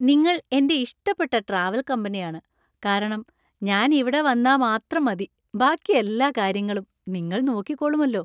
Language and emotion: Malayalam, happy